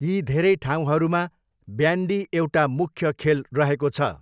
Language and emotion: Nepali, neutral